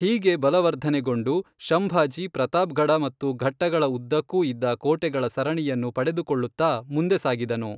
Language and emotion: Kannada, neutral